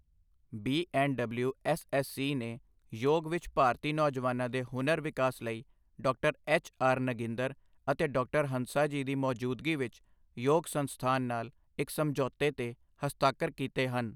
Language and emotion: Punjabi, neutral